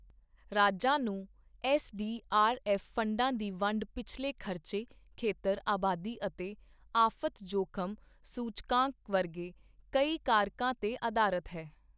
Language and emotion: Punjabi, neutral